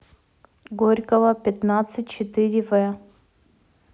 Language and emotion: Russian, neutral